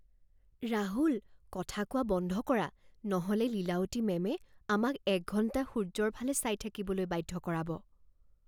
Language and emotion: Assamese, fearful